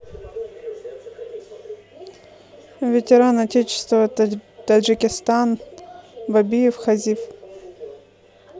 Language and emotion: Russian, neutral